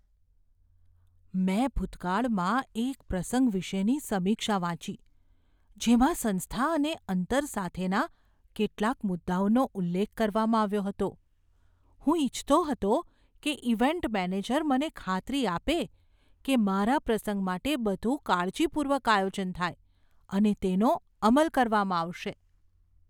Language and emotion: Gujarati, fearful